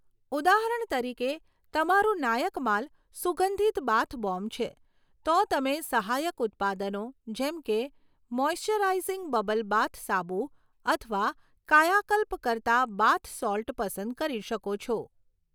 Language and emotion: Gujarati, neutral